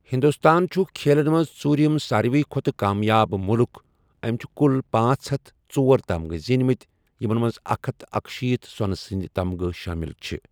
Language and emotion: Kashmiri, neutral